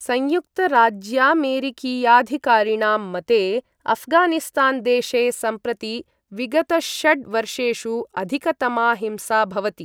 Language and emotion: Sanskrit, neutral